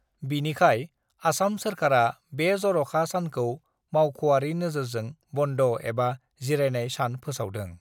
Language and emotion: Bodo, neutral